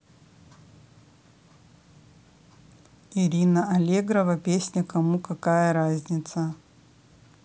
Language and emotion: Russian, neutral